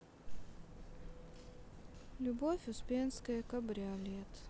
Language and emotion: Russian, sad